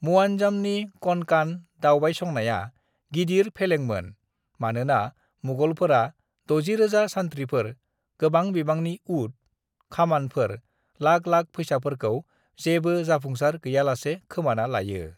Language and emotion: Bodo, neutral